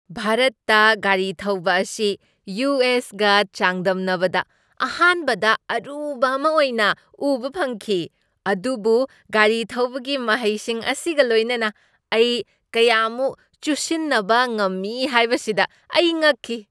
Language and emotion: Manipuri, surprised